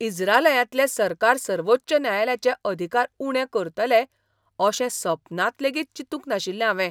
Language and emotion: Goan Konkani, surprised